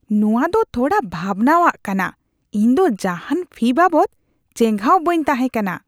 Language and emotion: Santali, disgusted